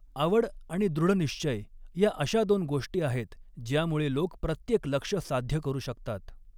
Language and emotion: Marathi, neutral